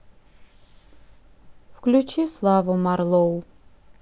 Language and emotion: Russian, sad